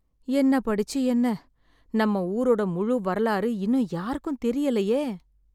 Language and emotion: Tamil, sad